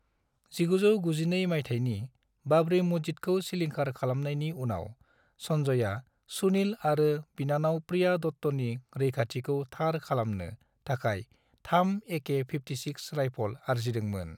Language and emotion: Bodo, neutral